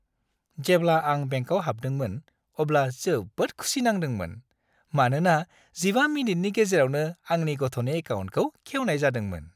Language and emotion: Bodo, happy